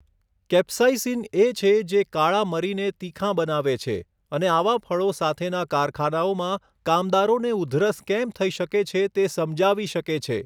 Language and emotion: Gujarati, neutral